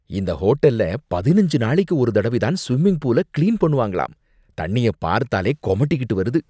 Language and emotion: Tamil, disgusted